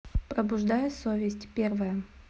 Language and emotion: Russian, neutral